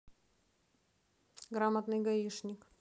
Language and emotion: Russian, neutral